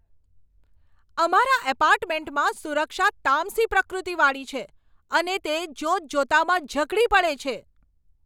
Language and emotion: Gujarati, angry